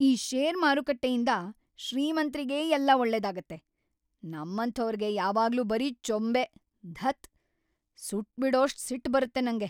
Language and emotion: Kannada, angry